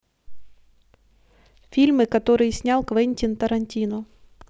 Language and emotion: Russian, neutral